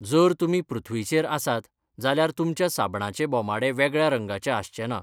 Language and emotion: Goan Konkani, neutral